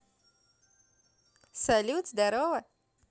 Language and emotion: Russian, positive